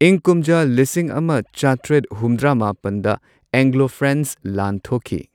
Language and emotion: Manipuri, neutral